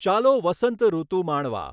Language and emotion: Gujarati, neutral